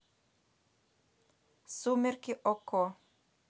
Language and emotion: Russian, neutral